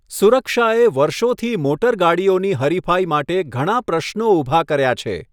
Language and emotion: Gujarati, neutral